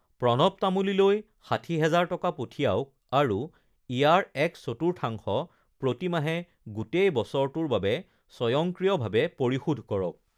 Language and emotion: Assamese, neutral